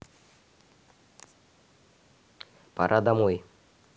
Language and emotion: Russian, neutral